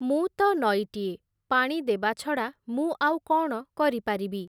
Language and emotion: Odia, neutral